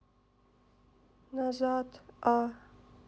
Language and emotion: Russian, sad